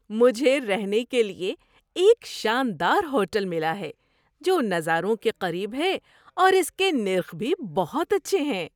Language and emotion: Urdu, happy